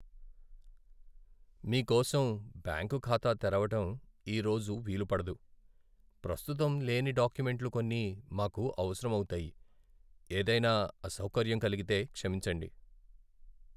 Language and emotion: Telugu, sad